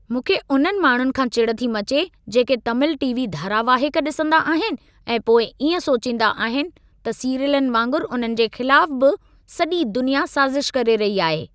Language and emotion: Sindhi, angry